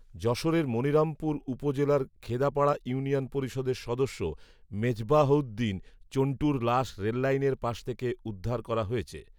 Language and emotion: Bengali, neutral